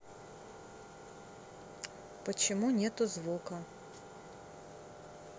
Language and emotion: Russian, neutral